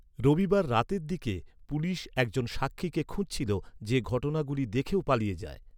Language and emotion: Bengali, neutral